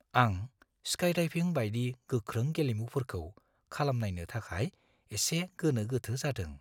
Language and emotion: Bodo, fearful